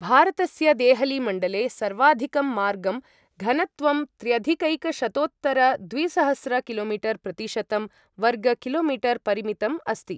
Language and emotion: Sanskrit, neutral